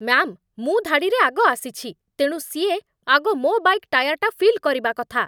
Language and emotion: Odia, angry